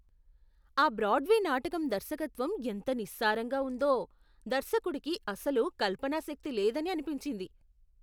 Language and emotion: Telugu, disgusted